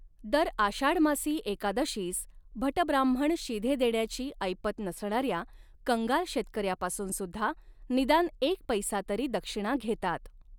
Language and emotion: Marathi, neutral